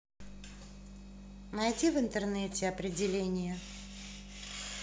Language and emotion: Russian, neutral